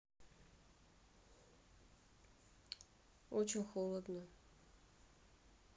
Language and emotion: Russian, neutral